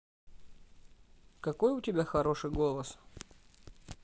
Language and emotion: Russian, positive